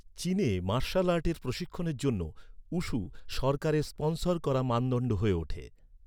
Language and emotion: Bengali, neutral